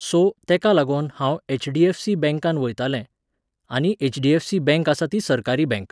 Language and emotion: Goan Konkani, neutral